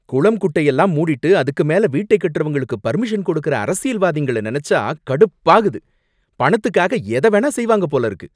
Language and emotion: Tamil, angry